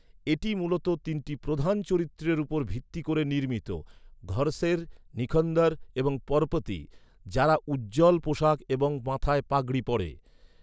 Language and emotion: Bengali, neutral